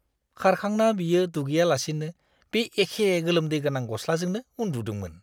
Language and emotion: Bodo, disgusted